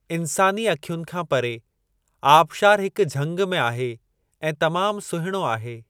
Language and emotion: Sindhi, neutral